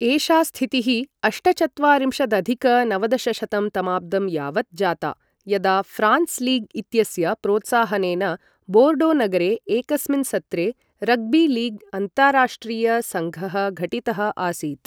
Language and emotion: Sanskrit, neutral